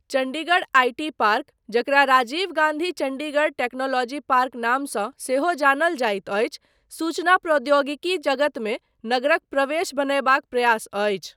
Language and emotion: Maithili, neutral